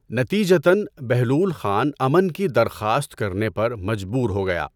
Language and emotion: Urdu, neutral